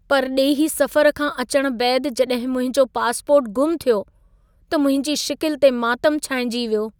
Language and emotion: Sindhi, sad